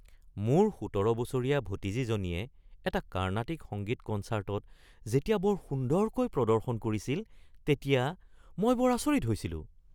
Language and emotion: Assamese, surprised